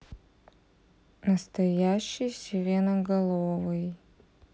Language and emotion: Russian, sad